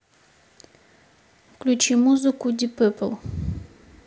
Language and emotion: Russian, neutral